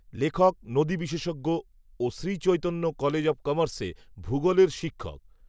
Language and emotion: Bengali, neutral